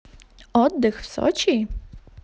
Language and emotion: Russian, positive